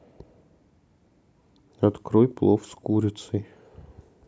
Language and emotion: Russian, sad